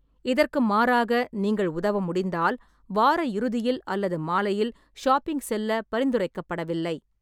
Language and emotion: Tamil, neutral